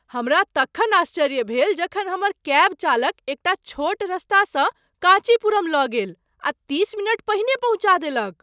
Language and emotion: Maithili, surprised